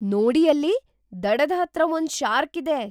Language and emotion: Kannada, surprised